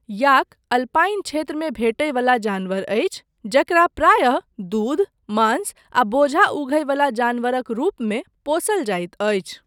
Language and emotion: Maithili, neutral